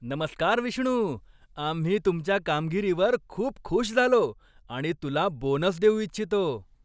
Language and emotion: Marathi, happy